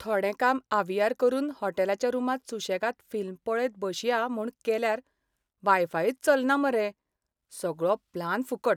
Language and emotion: Goan Konkani, sad